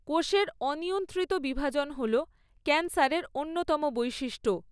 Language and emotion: Bengali, neutral